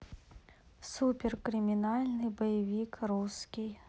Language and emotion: Russian, neutral